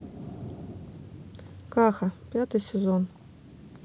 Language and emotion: Russian, neutral